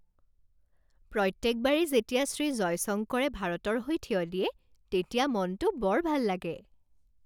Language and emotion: Assamese, happy